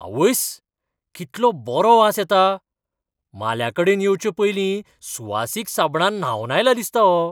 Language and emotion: Goan Konkani, surprised